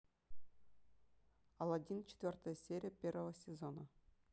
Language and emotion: Russian, neutral